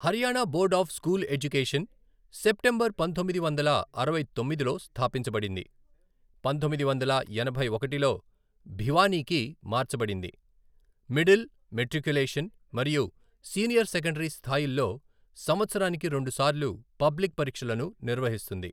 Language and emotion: Telugu, neutral